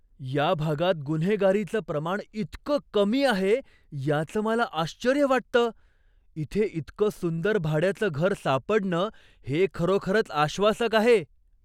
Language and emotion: Marathi, surprised